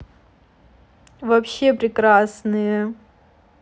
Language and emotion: Russian, positive